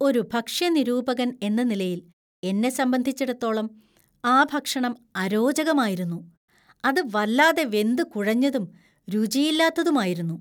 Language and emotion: Malayalam, disgusted